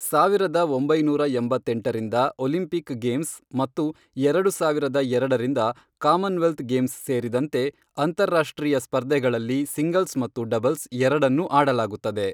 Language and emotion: Kannada, neutral